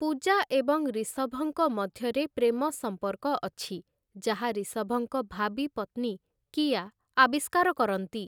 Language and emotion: Odia, neutral